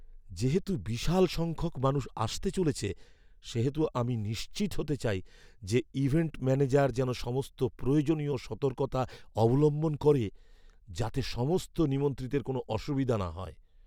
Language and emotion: Bengali, fearful